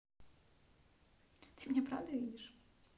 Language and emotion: Russian, neutral